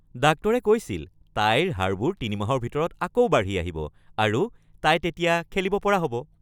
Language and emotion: Assamese, happy